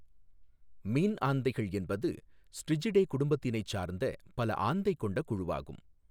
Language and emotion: Tamil, neutral